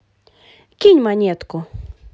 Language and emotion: Russian, positive